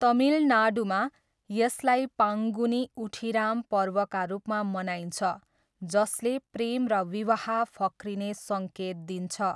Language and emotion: Nepali, neutral